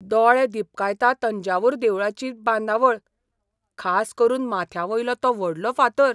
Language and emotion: Goan Konkani, surprised